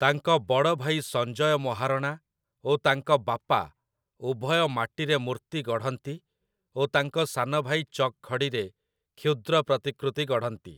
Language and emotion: Odia, neutral